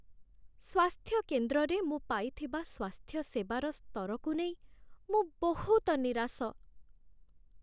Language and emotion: Odia, sad